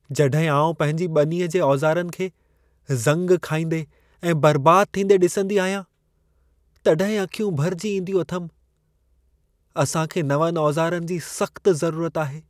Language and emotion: Sindhi, sad